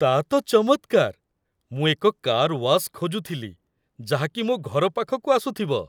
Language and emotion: Odia, happy